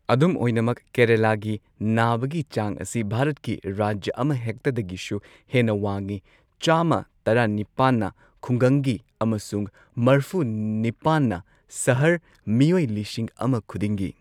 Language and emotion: Manipuri, neutral